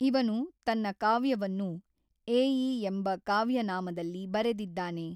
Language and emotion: Kannada, neutral